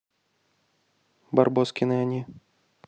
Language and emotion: Russian, neutral